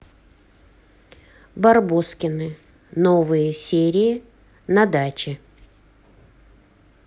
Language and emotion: Russian, neutral